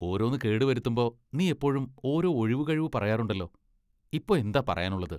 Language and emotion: Malayalam, disgusted